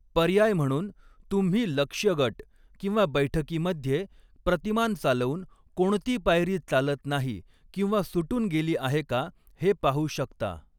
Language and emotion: Marathi, neutral